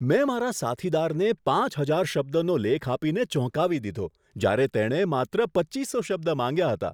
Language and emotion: Gujarati, surprised